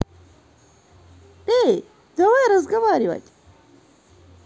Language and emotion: Russian, positive